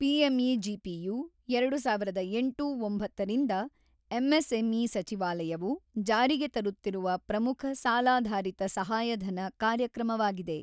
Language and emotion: Kannada, neutral